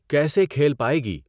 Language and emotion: Urdu, neutral